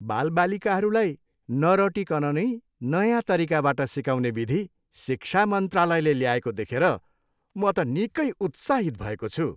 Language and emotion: Nepali, happy